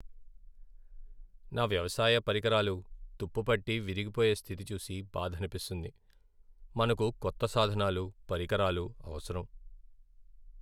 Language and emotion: Telugu, sad